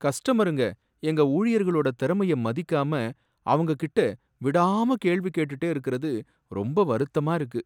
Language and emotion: Tamil, sad